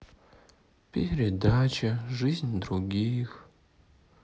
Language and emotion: Russian, sad